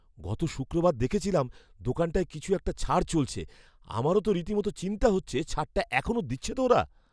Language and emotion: Bengali, fearful